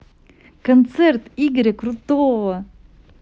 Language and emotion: Russian, positive